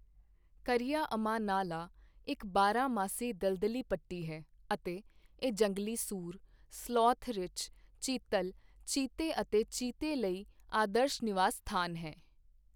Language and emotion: Punjabi, neutral